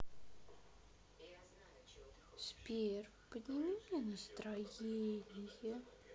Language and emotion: Russian, sad